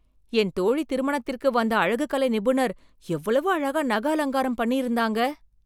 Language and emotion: Tamil, surprised